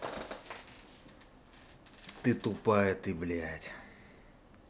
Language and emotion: Russian, angry